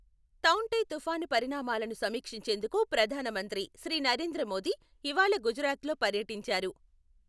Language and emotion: Telugu, neutral